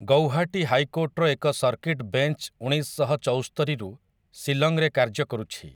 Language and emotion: Odia, neutral